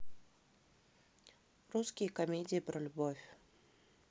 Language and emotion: Russian, neutral